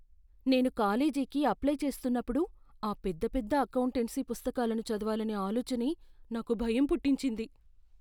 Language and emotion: Telugu, fearful